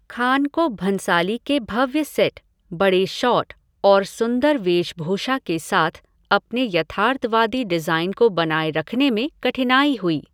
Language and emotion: Hindi, neutral